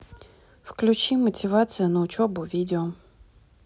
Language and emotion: Russian, neutral